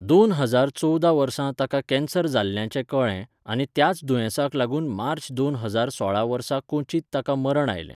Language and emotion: Goan Konkani, neutral